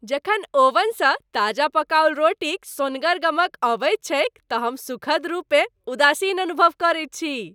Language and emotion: Maithili, happy